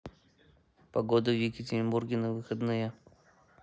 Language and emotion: Russian, neutral